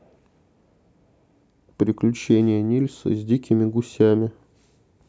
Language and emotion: Russian, neutral